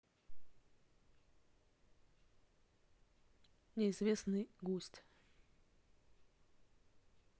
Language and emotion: Russian, neutral